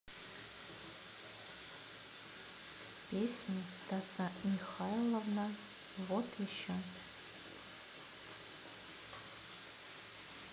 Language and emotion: Russian, neutral